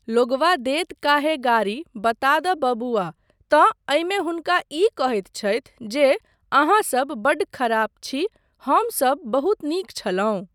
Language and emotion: Maithili, neutral